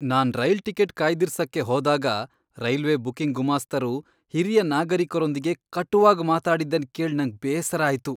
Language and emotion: Kannada, disgusted